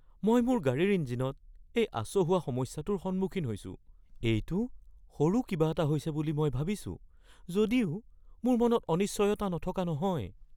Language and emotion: Assamese, fearful